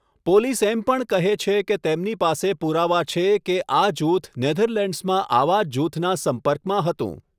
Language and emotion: Gujarati, neutral